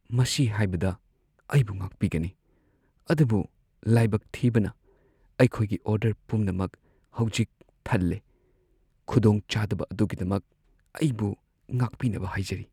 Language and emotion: Manipuri, sad